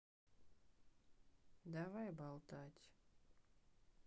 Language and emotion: Russian, sad